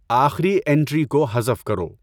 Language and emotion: Urdu, neutral